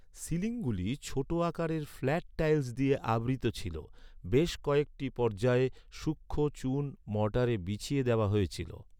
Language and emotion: Bengali, neutral